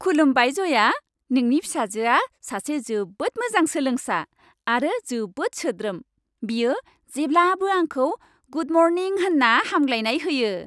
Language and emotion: Bodo, happy